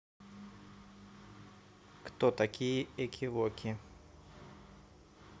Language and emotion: Russian, neutral